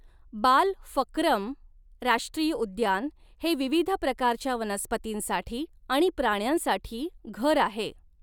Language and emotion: Marathi, neutral